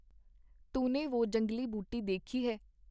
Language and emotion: Punjabi, neutral